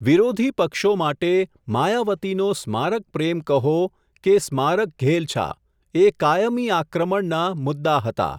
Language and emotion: Gujarati, neutral